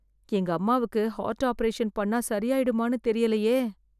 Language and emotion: Tamil, fearful